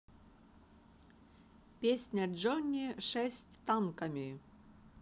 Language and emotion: Russian, positive